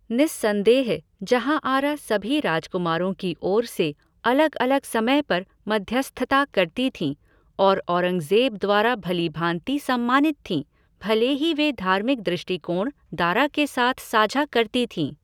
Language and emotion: Hindi, neutral